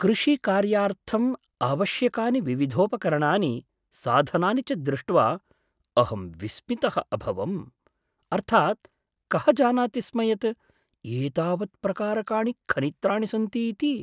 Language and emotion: Sanskrit, surprised